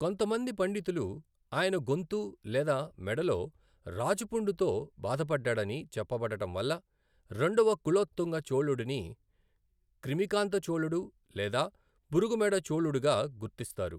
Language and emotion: Telugu, neutral